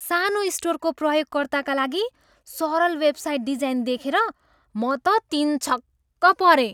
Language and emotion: Nepali, surprised